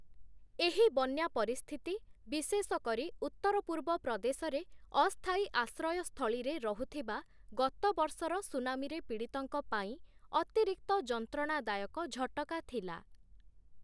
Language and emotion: Odia, neutral